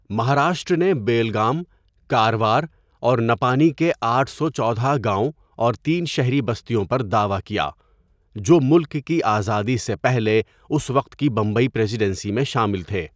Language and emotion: Urdu, neutral